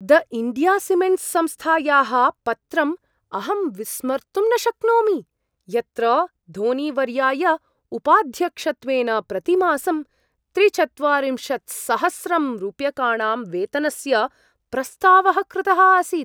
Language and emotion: Sanskrit, surprised